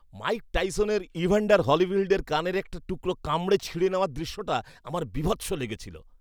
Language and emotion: Bengali, disgusted